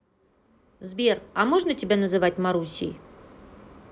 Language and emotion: Russian, positive